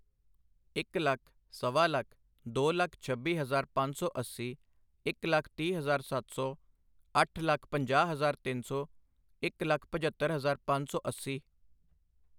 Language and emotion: Punjabi, neutral